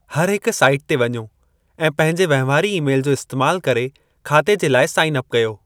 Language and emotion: Sindhi, neutral